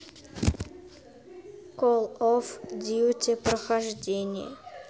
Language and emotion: Russian, neutral